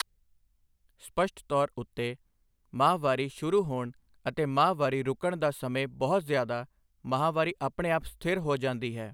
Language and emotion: Punjabi, neutral